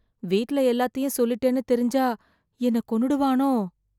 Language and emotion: Tamil, fearful